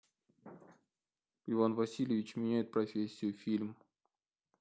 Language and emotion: Russian, neutral